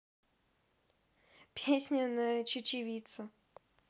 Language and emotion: Russian, positive